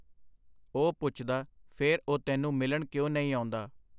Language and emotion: Punjabi, neutral